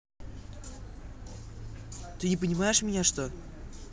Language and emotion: Russian, angry